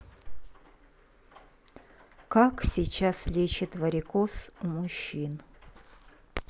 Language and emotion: Russian, neutral